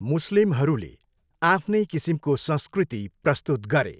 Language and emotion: Nepali, neutral